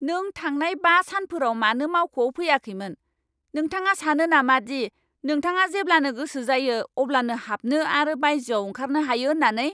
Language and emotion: Bodo, angry